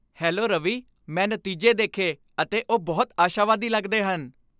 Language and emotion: Punjabi, happy